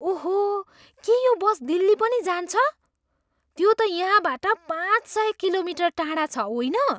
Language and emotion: Nepali, surprised